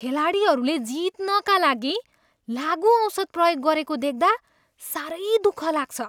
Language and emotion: Nepali, disgusted